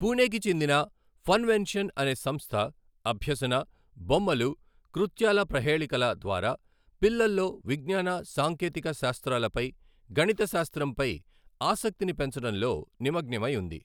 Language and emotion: Telugu, neutral